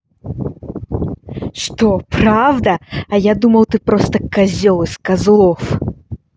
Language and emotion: Russian, angry